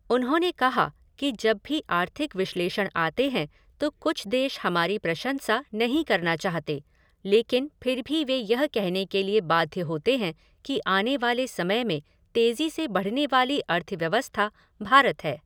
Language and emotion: Hindi, neutral